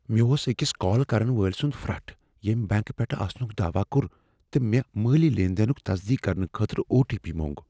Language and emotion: Kashmiri, fearful